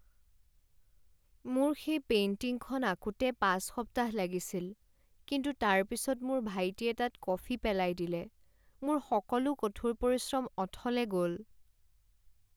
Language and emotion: Assamese, sad